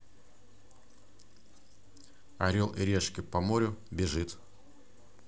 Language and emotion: Russian, neutral